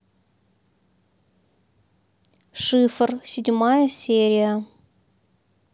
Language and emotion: Russian, neutral